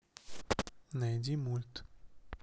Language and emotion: Russian, neutral